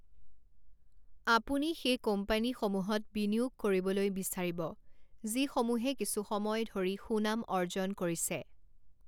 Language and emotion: Assamese, neutral